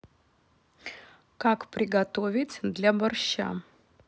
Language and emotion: Russian, neutral